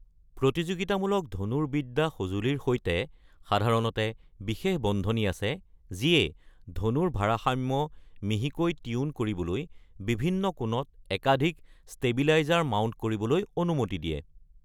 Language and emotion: Assamese, neutral